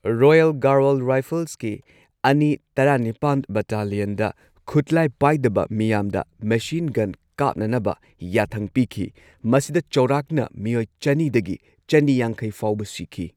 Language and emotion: Manipuri, neutral